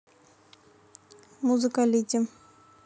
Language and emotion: Russian, neutral